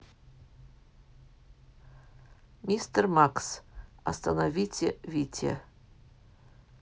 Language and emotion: Russian, neutral